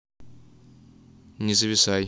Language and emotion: Russian, neutral